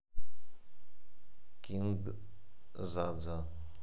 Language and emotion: Russian, neutral